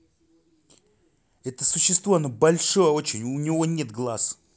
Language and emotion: Russian, angry